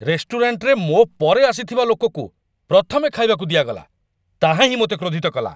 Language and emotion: Odia, angry